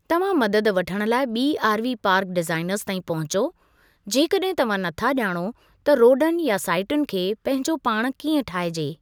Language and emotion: Sindhi, neutral